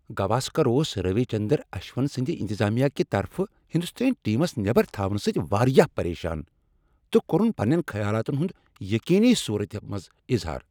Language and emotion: Kashmiri, angry